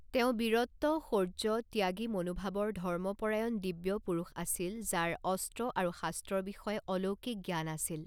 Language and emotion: Assamese, neutral